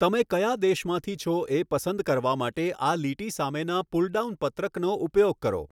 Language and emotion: Gujarati, neutral